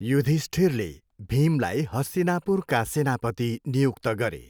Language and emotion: Nepali, neutral